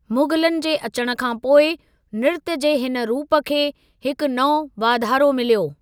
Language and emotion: Sindhi, neutral